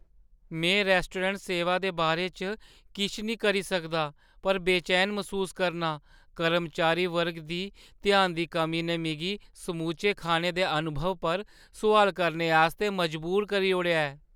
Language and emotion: Dogri, fearful